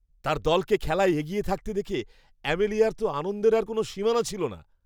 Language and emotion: Bengali, happy